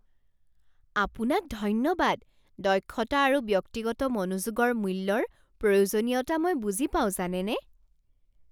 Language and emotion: Assamese, surprised